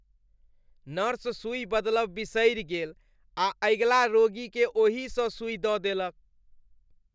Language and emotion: Maithili, disgusted